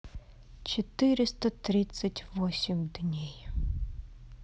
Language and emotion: Russian, sad